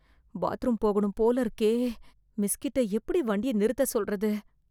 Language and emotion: Tamil, fearful